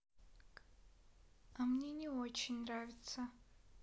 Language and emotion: Russian, sad